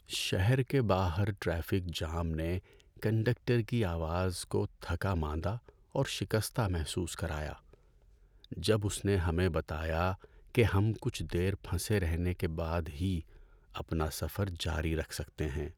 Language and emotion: Urdu, sad